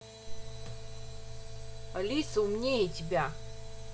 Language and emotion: Russian, angry